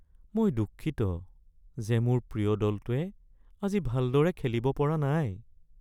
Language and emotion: Assamese, sad